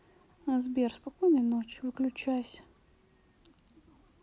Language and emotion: Russian, sad